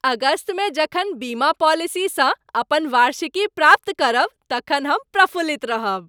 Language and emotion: Maithili, happy